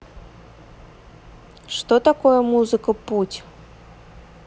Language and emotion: Russian, neutral